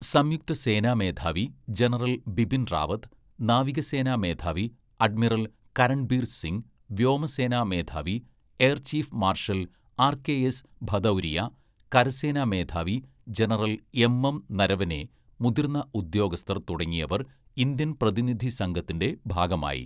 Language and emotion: Malayalam, neutral